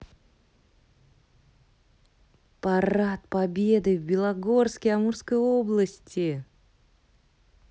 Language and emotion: Russian, positive